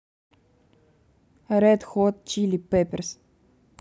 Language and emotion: Russian, neutral